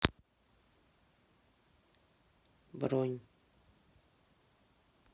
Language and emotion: Russian, sad